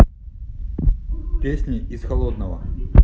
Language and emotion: Russian, neutral